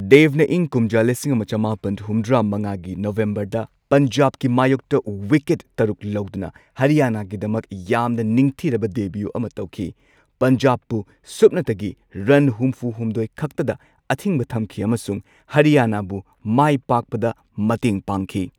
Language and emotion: Manipuri, neutral